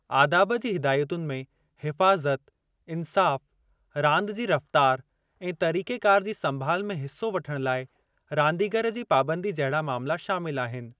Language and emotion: Sindhi, neutral